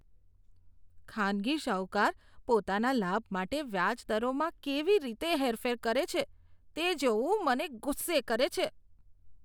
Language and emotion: Gujarati, disgusted